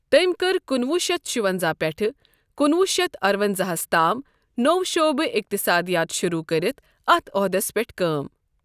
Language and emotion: Kashmiri, neutral